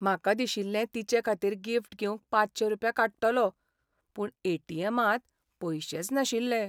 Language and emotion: Goan Konkani, sad